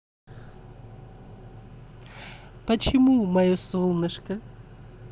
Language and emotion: Russian, positive